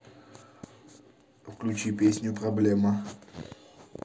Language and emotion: Russian, neutral